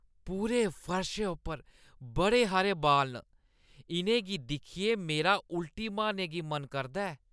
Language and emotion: Dogri, disgusted